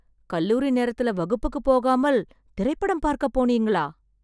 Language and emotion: Tamil, surprised